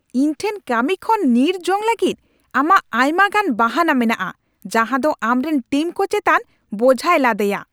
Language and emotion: Santali, angry